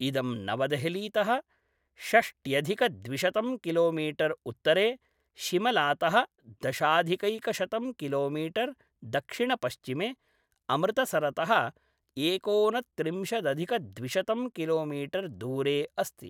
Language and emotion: Sanskrit, neutral